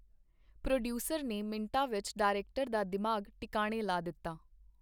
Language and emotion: Punjabi, neutral